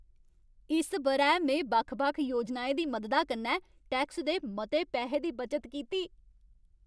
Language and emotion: Dogri, happy